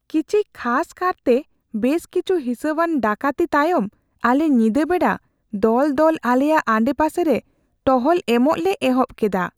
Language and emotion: Santali, fearful